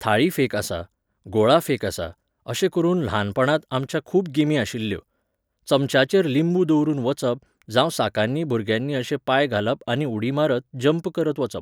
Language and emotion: Goan Konkani, neutral